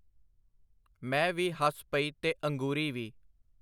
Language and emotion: Punjabi, neutral